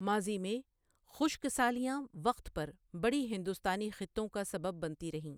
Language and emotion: Urdu, neutral